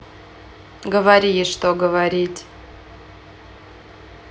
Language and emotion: Russian, neutral